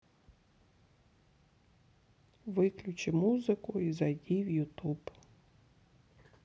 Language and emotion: Russian, sad